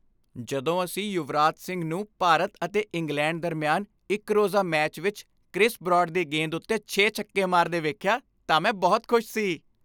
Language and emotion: Punjabi, happy